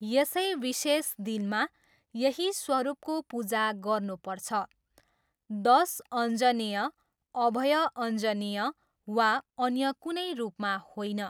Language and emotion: Nepali, neutral